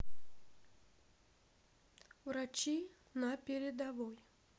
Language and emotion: Russian, neutral